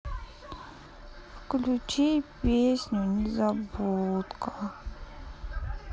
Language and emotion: Russian, sad